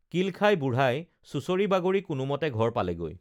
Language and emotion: Assamese, neutral